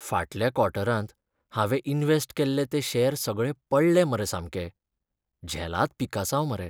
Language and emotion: Goan Konkani, sad